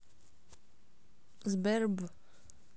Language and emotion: Russian, neutral